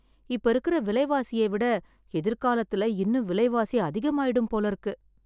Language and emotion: Tamil, sad